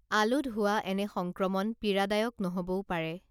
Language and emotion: Assamese, neutral